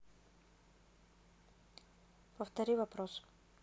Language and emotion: Russian, neutral